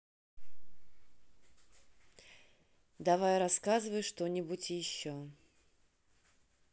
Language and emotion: Russian, neutral